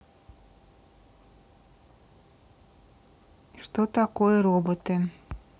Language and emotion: Russian, neutral